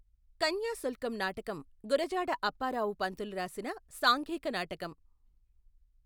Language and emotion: Telugu, neutral